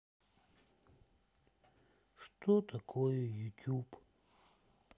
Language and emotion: Russian, sad